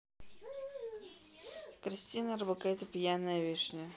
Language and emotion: Russian, neutral